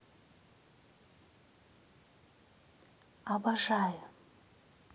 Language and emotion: Russian, positive